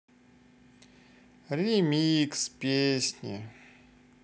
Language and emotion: Russian, sad